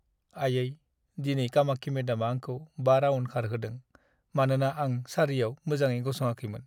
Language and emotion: Bodo, sad